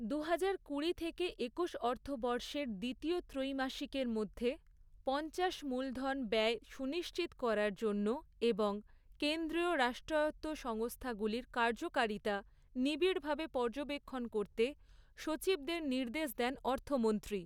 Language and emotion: Bengali, neutral